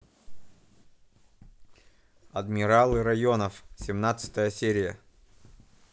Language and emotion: Russian, neutral